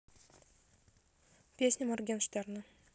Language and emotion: Russian, neutral